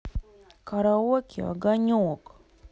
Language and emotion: Russian, neutral